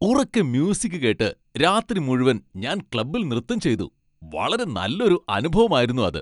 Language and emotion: Malayalam, happy